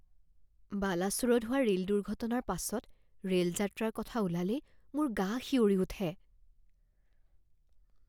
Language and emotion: Assamese, fearful